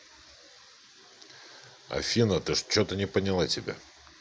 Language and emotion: Russian, neutral